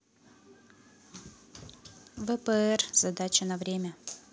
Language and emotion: Russian, neutral